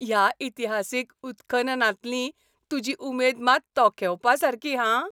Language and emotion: Goan Konkani, happy